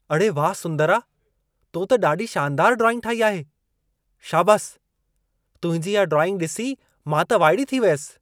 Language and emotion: Sindhi, surprised